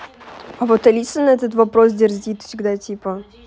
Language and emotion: Russian, neutral